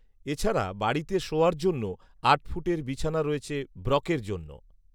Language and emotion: Bengali, neutral